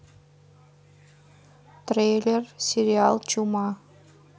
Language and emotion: Russian, neutral